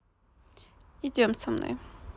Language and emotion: Russian, neutral